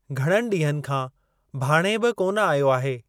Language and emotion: Sindhi, neutral